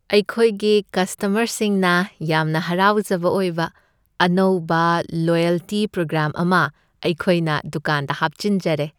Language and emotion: Manipuri, happy